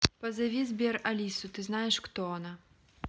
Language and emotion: Russian, neutral